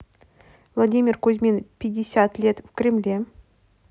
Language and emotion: Russian, neutral